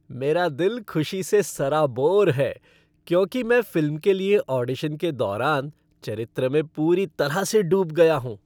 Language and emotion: Hindi, happy